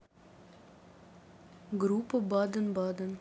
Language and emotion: Russian, neutral